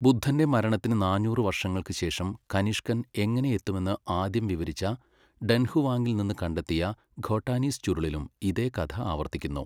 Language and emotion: Malayalam, neutral